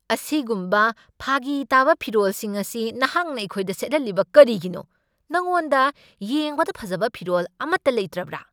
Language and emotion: Manipuri, angry